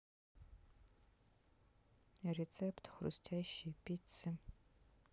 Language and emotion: Russian, neutral